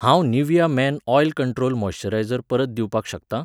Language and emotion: Goan Konkani, neutral